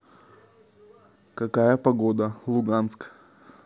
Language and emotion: Russian, neutral